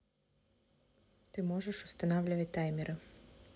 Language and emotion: Russian, neutral